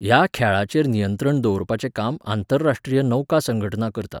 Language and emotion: Goan Konkani, neutral